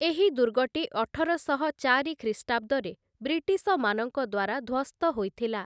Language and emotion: Odia, neutral